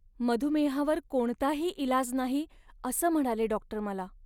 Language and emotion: Marathi, sad